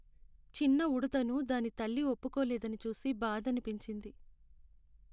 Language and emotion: Telugu, sad